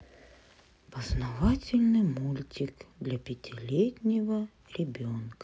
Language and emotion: Russian, sad